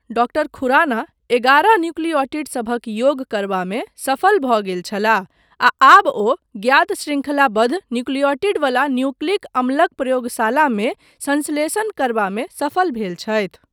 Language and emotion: Maithili, neutral